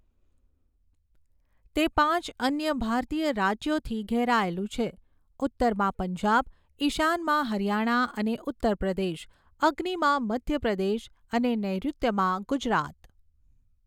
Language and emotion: Gujarati, neutral